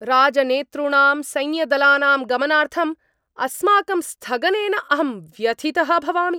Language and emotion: Sanskrit, angry